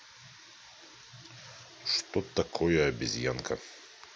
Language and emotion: Russian, neutral